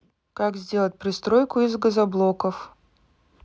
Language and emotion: Russian, neutral